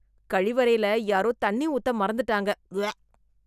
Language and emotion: Tamil, disgusted